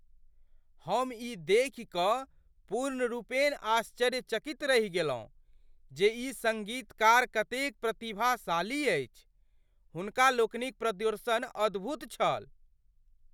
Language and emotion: Maithili, surprised